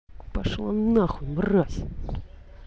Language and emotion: Russian, angry